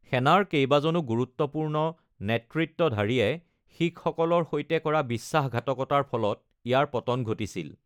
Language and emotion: Assamese, neutral